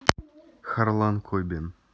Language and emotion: Russian, neutral